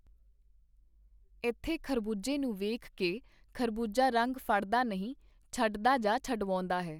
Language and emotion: Punjabi, neutral